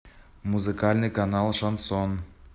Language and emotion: Russian, neutral